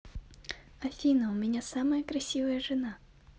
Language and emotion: Russian, positive